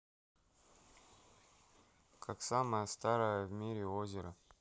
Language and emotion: Russian, neutral